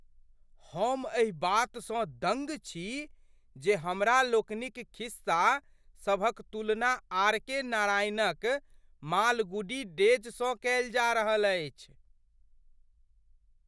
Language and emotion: Maithili, surprised